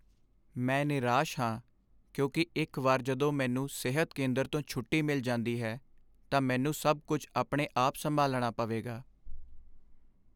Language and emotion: Punjabi, sad